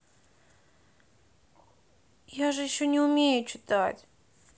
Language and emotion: Russian, sad